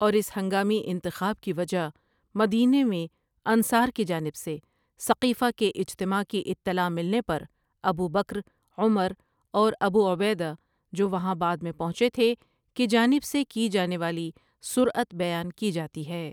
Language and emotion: Urdu, neutral